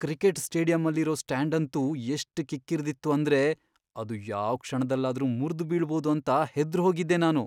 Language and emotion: Kannada, fearful